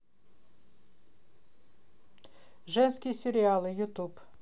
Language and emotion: Russian, neutral